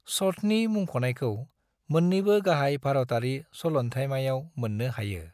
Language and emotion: Bodo, neutral